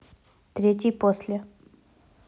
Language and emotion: Russian, neutral